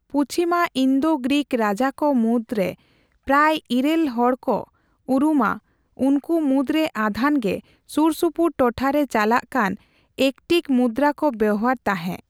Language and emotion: Santali, neutral